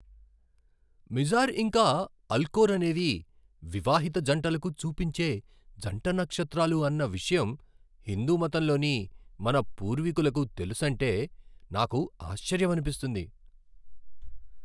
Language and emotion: Telugu, surprised